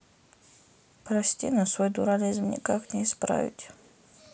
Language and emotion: Russian, sad